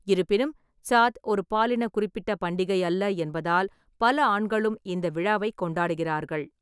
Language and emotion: Tamil, neutral